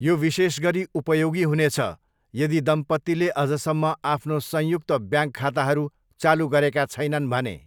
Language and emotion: Nepali, neutral